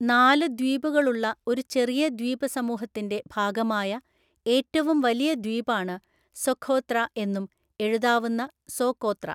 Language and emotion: Malayalam, neutral